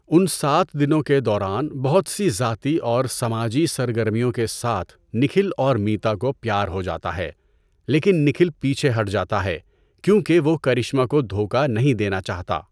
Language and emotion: Urdu, neutral